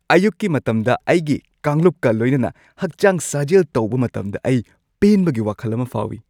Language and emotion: Manipuri, happy